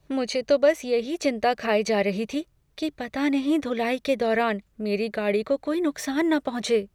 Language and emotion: Hindi, fearful